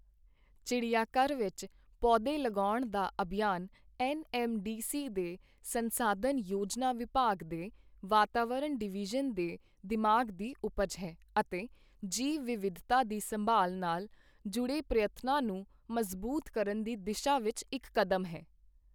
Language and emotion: Punjabi, neutral